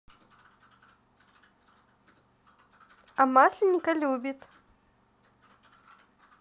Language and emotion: Russian, positive